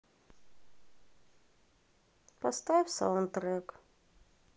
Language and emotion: Russian, sad